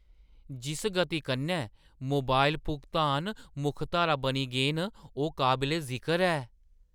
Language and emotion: Dogri, surprised